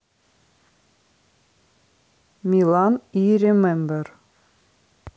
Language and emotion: Russian, neutral